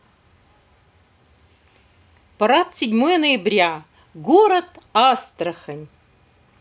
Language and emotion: Russian, positive